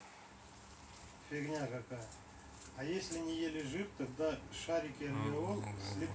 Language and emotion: Russian, neutral